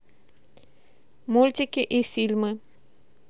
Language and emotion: Russian, neutral